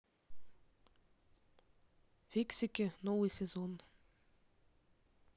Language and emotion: Russian, neutral